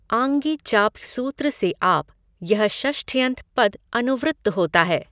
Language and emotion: Hindi, neutral